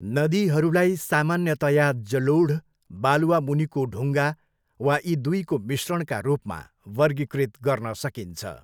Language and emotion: Nepali, neutral